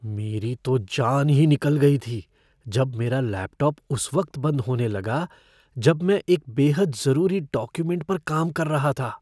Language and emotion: Hindi, fearful